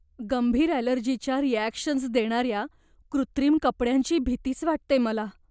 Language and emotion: Marathi, fearful